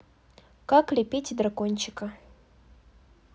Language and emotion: Russian, neutral